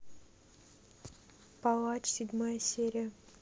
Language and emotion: Russian, neutral